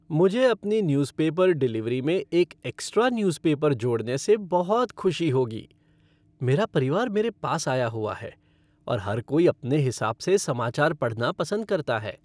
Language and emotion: Hindi, happy